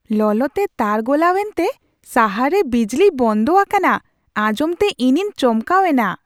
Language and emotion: Santali, surprised